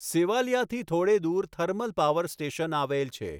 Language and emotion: Gujarati, neutral